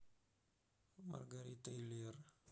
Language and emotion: Russian, neutral